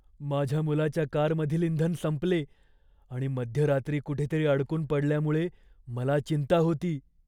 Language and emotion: Marathi, fearful